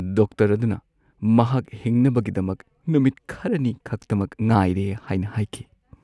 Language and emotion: Manipuri, sad